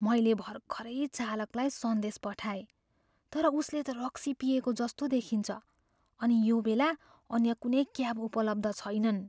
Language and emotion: Nepali, fearful